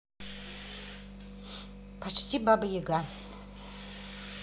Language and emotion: Russian, positive